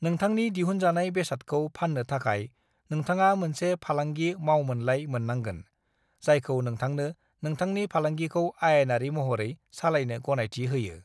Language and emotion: Bodo, neutral